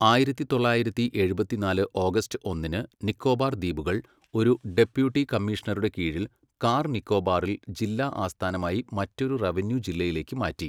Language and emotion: Malayalam, neutral